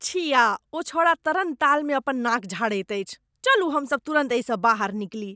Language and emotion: Maithili, disgusted